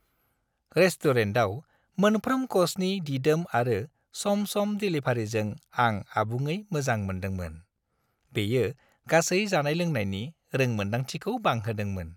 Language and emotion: Bodo, happy